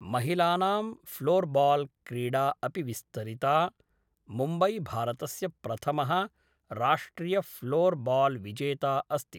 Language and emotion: Sanskrit, neutral